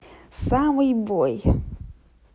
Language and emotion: Russian, positive